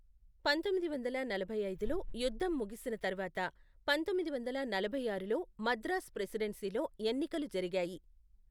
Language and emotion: Telugu, neutral